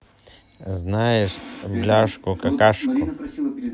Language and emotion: Russian, neutral